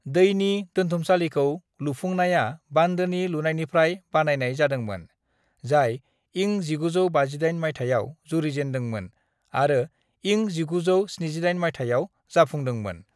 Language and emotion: Bodo, neutral